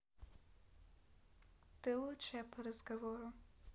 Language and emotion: Russian, neutral